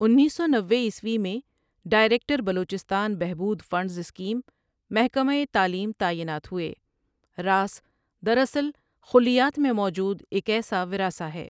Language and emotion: Urdu, neutral